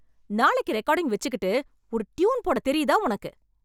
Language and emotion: Tamil, angry